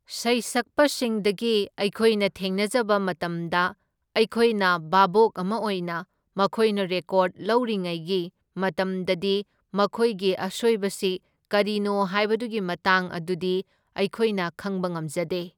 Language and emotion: Manipuri, neutral